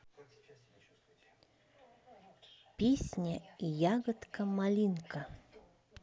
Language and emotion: Russian, neutral